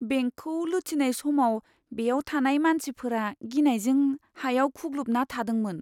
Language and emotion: Bodo, fearful